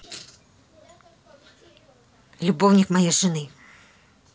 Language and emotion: Russian, neutral